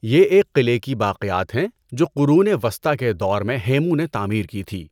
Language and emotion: Urdu, neutral